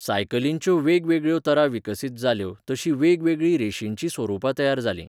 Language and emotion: Goan Konkani, neutral